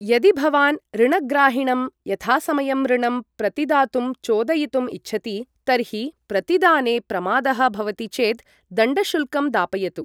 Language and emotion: Sanskrit, neutral